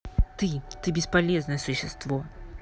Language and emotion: Russian, angry